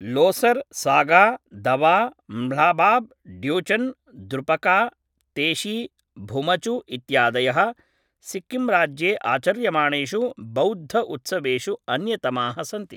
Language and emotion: Sanskrit, neutral